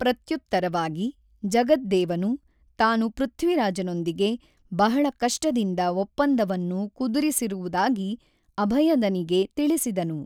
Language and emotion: Kannada, neutral